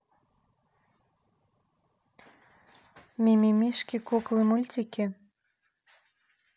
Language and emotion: Russian, neutral